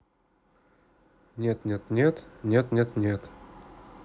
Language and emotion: Russian, neutral